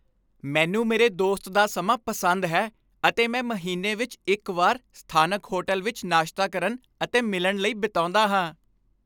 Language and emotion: Punjabi, happy